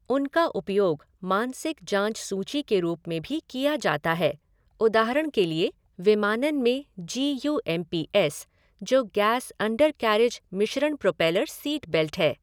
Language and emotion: Hindi, neutral